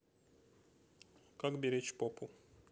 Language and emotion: Russian, neutral